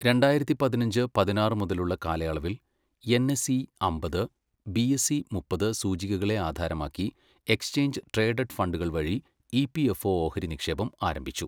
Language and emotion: Malayalam, neutral